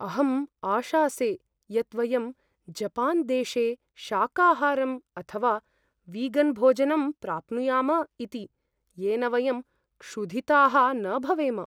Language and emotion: Sanskrit, fearful